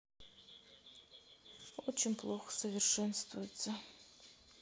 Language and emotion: Russian, sad